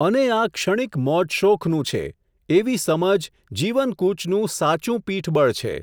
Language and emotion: Gujarati, neutral